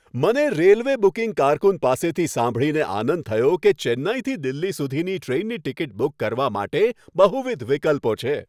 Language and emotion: Gujarati, happy